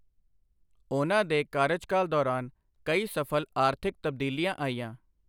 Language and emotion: Punjabi, neutral